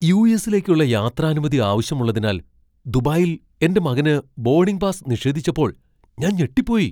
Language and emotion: Malayalam, surprised